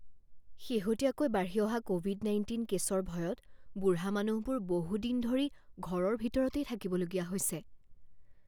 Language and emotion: Assamese, fearful